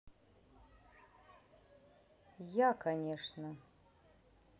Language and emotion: Russian, neutral